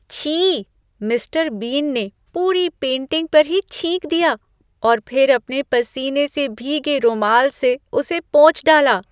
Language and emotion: Hindi, disgusted